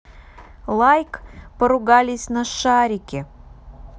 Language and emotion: Russian, neutral